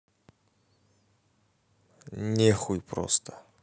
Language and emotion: Russian, neutral